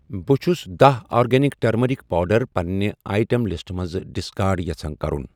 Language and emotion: Kashmiri, neutral